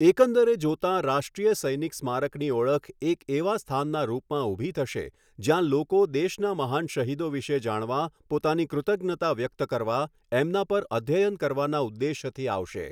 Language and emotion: Gujarati, neutral